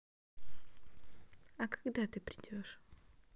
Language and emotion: Russian, neutral